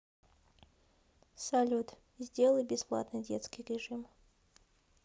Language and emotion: Russian, neutral